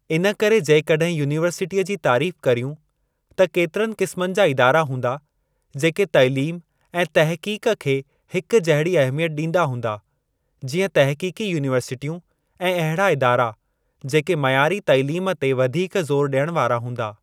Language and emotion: Sindhi, neutral